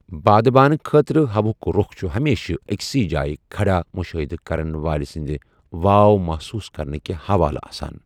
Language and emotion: Kashmiri, neutral